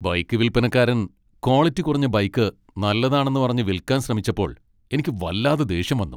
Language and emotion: Malayalam, angry